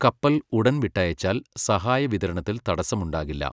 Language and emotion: Malayalam, neutral